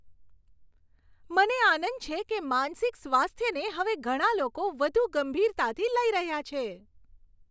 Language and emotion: Gujarati, happy